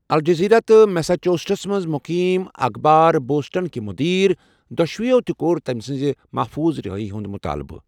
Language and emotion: Kashmiri, neutral